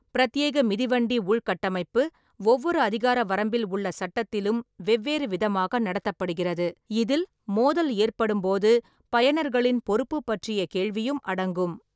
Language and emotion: Tamil, neutral